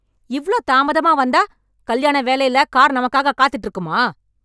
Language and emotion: Tamil, angry